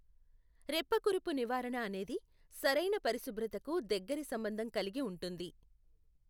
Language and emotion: Telugu, neutral